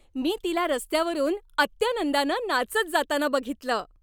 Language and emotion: Marathi, happy